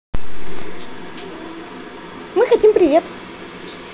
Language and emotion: Russian, positive